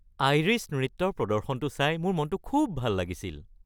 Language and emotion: Assamese, happy